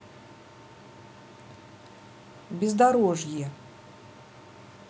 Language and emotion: Russian, neutral